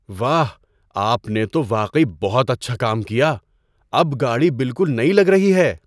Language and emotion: Urdu, surprised